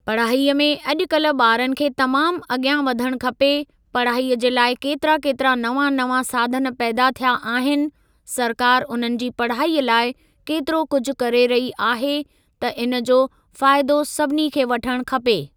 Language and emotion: Sindhi, neutral